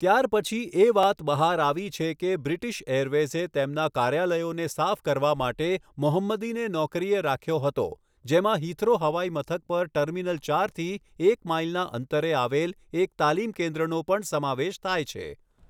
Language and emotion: Gujarati, neutral